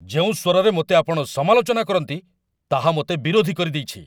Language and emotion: Odia, angry